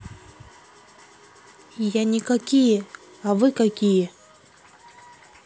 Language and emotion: Russian, neutral